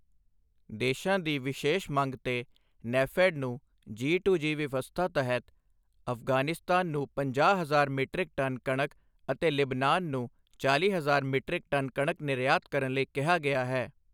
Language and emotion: Punjabi, neutral